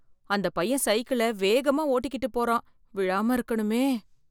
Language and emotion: Tamil, fearful